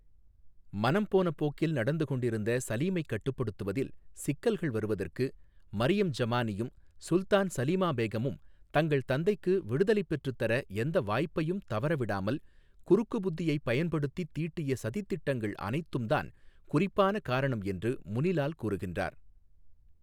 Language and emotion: Tamil, neutral